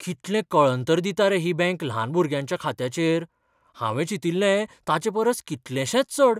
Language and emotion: Goan Konkani, surprised